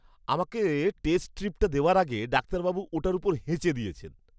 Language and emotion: Bengali, disgusted